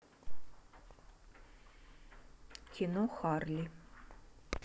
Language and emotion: Russian, neutral